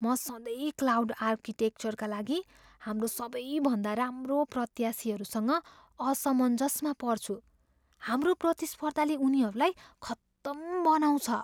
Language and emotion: Nepali, fearful